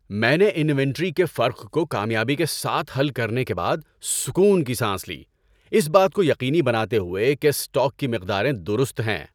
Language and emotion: Urdu, happy